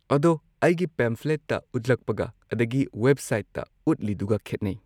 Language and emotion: Manipuri, neutral